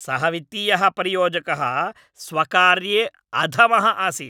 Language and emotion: Sanskrit, angry